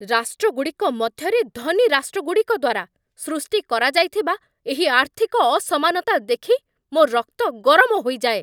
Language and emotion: Odia, angry